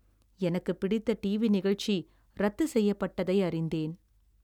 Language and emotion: Tamil, sad